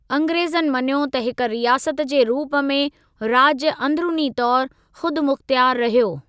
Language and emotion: Sindhi, neutral